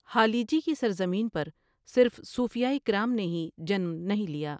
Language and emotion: Urdu, neutral